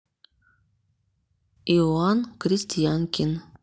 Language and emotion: Russian, neutral